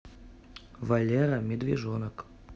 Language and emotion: Russian, neutral